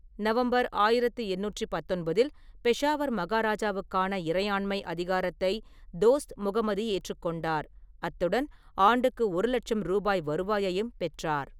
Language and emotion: Tamil, neutral